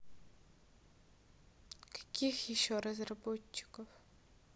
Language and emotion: Russian, neutral